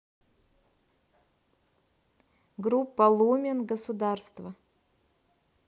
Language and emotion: Russian, neutral